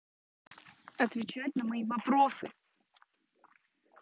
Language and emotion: Russian, angry